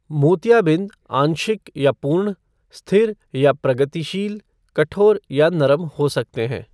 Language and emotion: Hindi, neutral